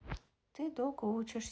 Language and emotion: Russian, neutral